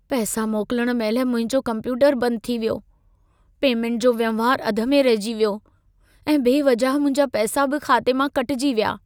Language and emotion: Sindhi, sad